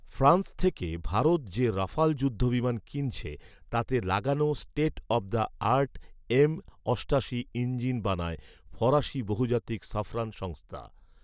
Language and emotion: Bengali, neutral